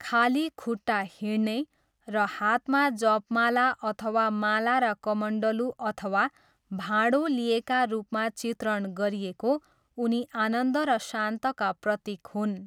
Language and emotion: Nepali, neutral